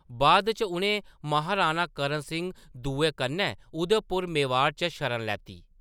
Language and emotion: Dogri, neutral